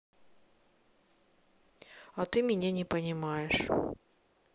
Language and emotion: Russian, sad